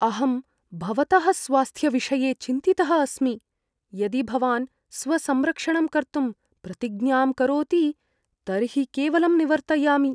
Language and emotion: Sanskrit, fearful